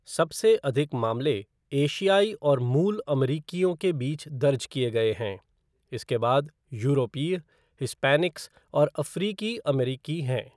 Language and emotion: Hindi, neutral